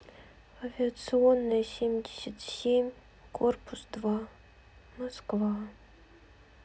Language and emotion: Russian, sad